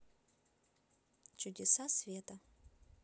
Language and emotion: Russian, neutral